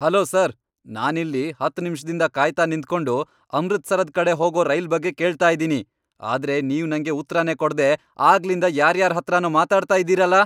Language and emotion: Kannada, angry